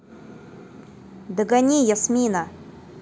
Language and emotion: Russian, neutral